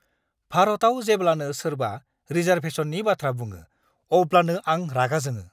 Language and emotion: Bodo, angry